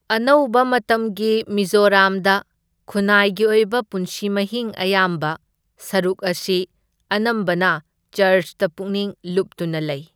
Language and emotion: Manipuri, neutral